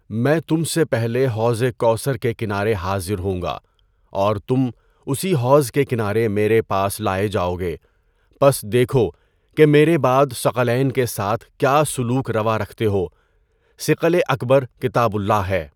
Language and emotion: Urdu, neutral